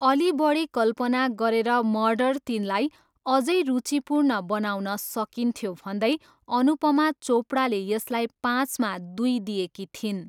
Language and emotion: Nepali, neutral